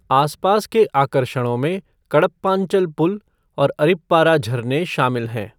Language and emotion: Hindi, neutral